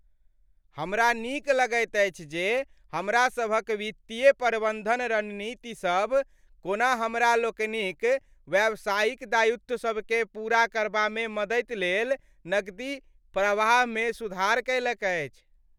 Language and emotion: Maithili, happy